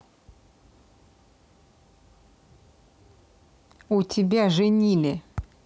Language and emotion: Russian, neutral